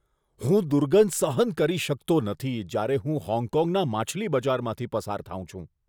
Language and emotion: Gujarati, disgusted